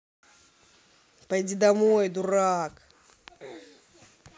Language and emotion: Russian, angry